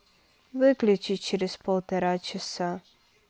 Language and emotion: Russian, sad